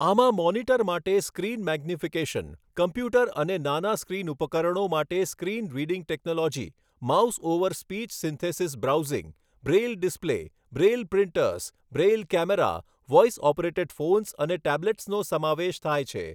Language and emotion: Gujarati, neutral